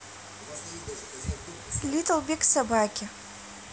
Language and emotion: Russian, neutral